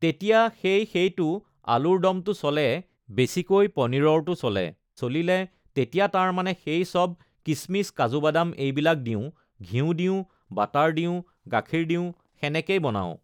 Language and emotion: Assamese, neutral